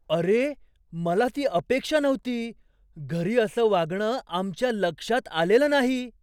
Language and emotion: Marathi, surprised